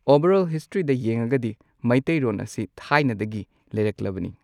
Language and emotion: Manipuri, neutral